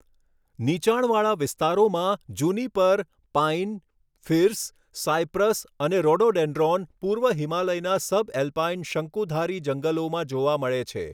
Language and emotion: Gujarati, neutral